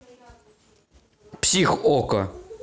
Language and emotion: Russian, neutral